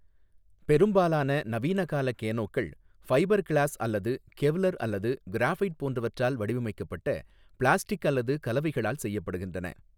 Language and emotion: Tamil, neutral